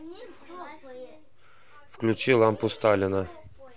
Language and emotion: Russian, neutral